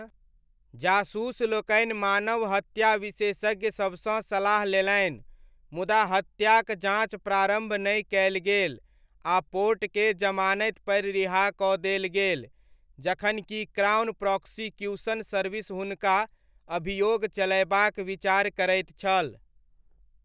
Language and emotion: Maithili, neutral